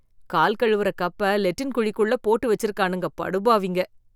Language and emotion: Tamil, disgusted